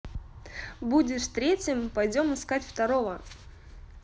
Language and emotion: Russian, positive